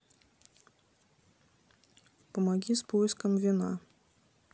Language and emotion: Russian, neutral